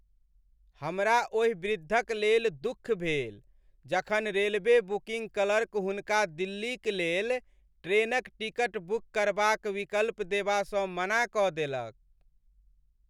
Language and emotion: Maithili, sad